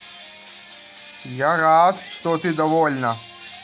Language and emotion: Russian, positive